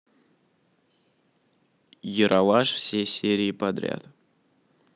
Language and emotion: Russian, neutral